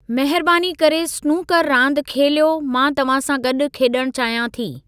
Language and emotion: Sindhi, neutral